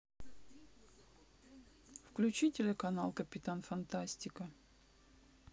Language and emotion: Russian, neutral